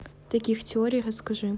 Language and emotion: Russian, neutral